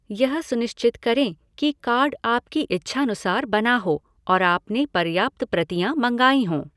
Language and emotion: Hindi, neutral